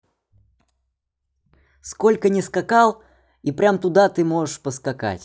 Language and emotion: Russian, neutral